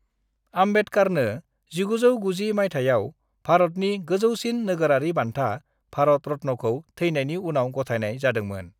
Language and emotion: Bodo, neutral